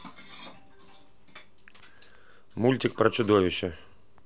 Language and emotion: Russian, neutral